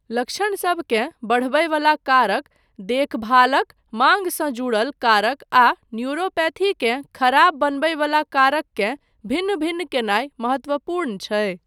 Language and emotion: Maithili, neutral